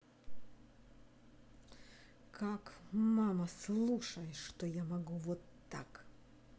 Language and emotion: Russian, angry